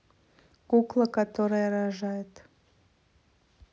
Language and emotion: Russian, neutral